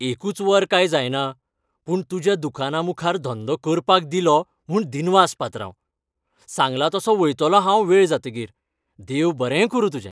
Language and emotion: Goan Konkani, happy